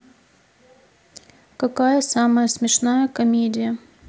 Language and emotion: Russian, neutral